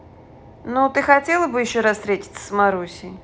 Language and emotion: Russian, neutral